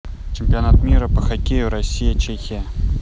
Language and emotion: Russian, neutral